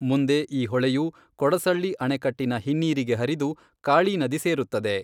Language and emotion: Kannada, neutral